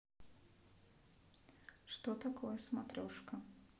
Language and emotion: Russian, neutral